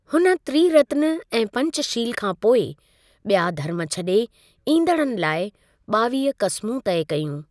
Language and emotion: Sindhi, neutral